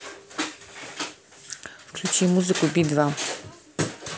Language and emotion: Russian, neutral